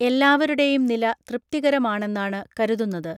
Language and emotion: Malayalam, neutral